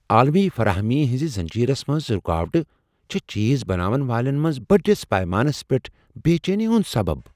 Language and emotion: Kashmiri, fearful